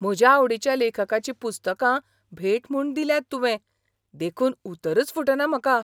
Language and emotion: Goan Konkani, surprised